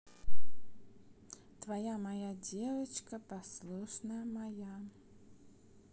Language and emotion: Russian, neutral